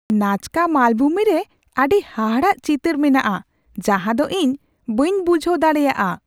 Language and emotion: Santali, surprised